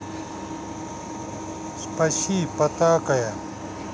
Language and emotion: Russian, neutral